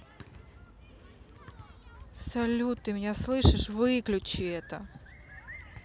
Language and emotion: Russian, angry